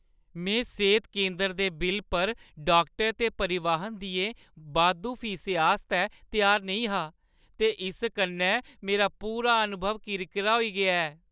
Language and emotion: Dogri, sad